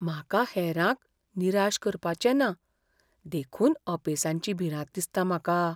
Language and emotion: Goan Konkani, fearful